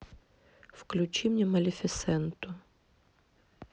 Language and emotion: Russian, neutral